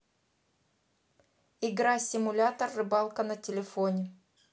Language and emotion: Russian, neutral